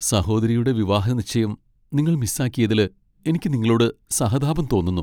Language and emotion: Malayalam, sad